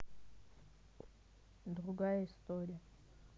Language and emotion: Russian, neutral